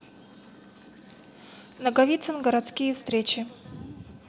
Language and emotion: Russian, neutral